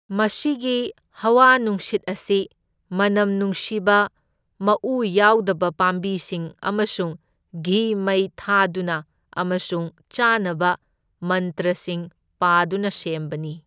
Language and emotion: Manipuri, neutral